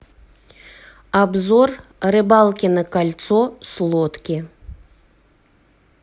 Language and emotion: Russian, neutral